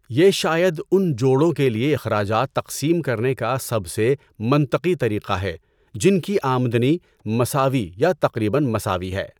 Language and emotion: Urdu, neutral